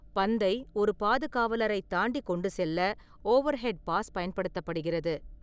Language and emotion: Tamil, neutral